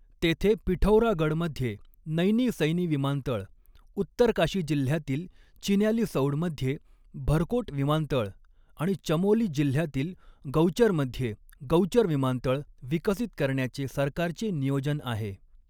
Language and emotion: Marathi, neutral